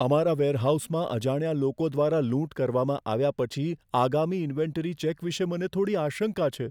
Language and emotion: Gujarati, fearful